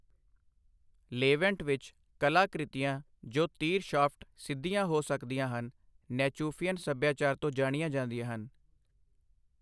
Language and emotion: Punjabi, neutral